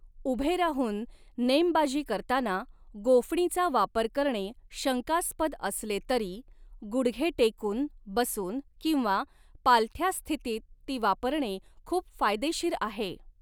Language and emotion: Marathi, neutral